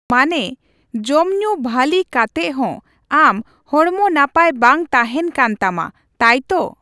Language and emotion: Santali, neutral